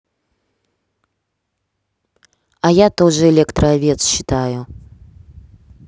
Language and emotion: Russian, neutral